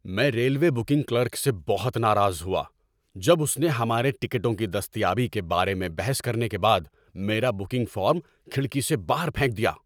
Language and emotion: Urdu, angry